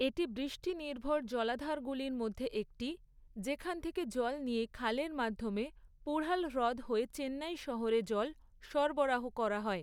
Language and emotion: Bengali, neutral